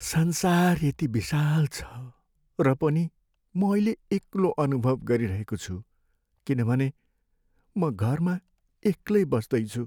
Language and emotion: Nepali, sad